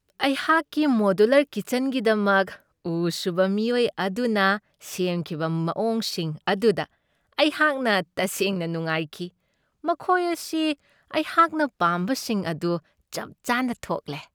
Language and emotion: Manipuri, happy